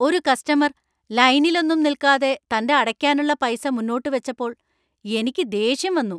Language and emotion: Malayalam, angry